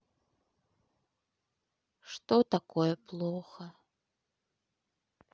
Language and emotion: Russian, sad